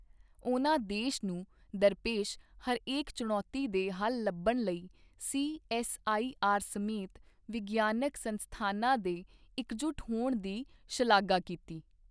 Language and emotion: Punjabi, neutral